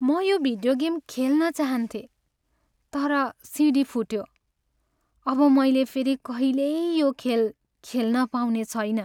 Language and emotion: Nepali, sad